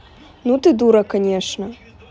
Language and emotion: Russian, neutral